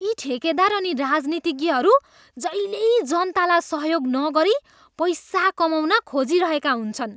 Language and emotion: Nepali, disgusted